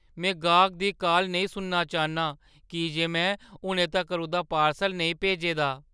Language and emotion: Dogri, fearful